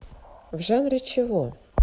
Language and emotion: Russian, neutral